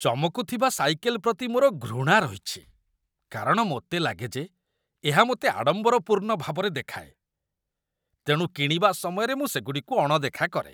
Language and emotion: Odia, disgusted